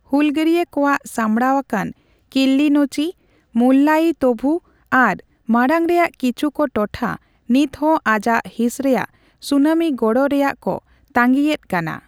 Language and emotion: Santali, neutral